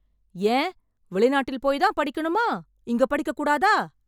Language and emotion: Tamil, angry